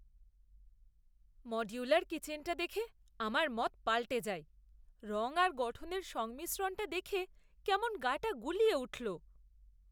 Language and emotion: Bengali, disgusted